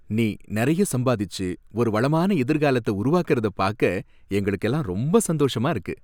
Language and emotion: Tamil, happy